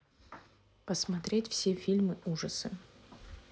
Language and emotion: Russian, neutral